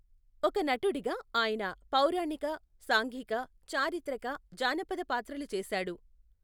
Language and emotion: Telugu, neutral